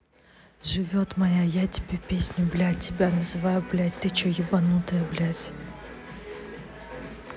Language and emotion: Russian, neutral